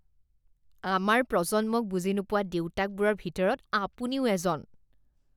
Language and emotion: Assamese, disgusted